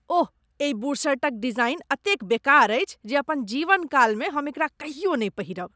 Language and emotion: Maithili, disgusted